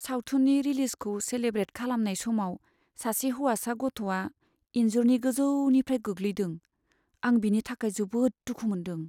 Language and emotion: Bodo, sad